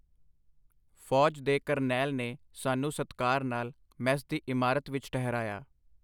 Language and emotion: Punjabi, neutral